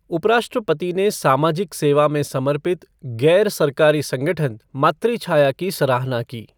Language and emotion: Hindi, neutral